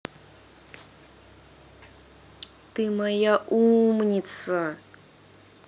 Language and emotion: Russian, positive